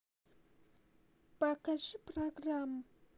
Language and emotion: Russian, neutral